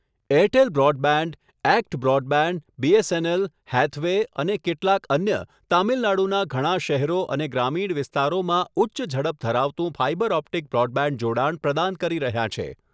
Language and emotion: Gujarati, neutral